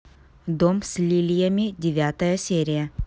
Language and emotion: Russian, neutral